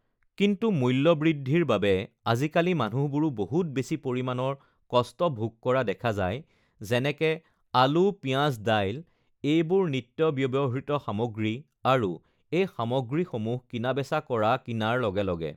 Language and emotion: Assamese, neutral